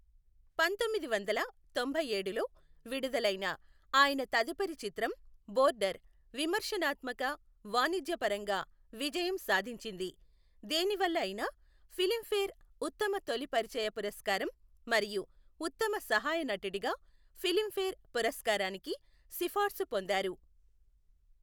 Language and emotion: Telugu, neutral